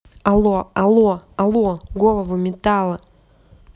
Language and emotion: Russian, angry